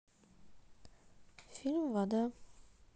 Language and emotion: Russian, neutral